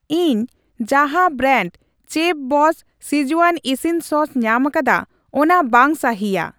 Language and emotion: Santali, neutral